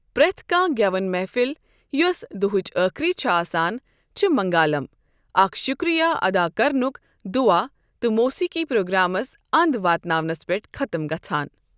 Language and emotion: Kashmiri, neutral